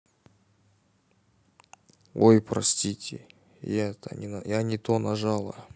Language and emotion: Russian, neutral